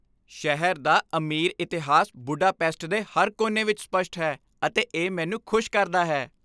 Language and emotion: Punjabi, happy